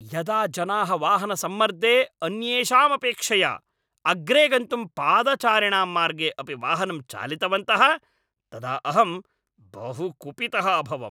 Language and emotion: Sanskrit, angry